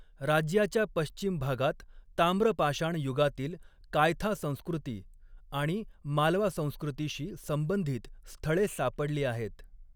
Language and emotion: Marathi, neutral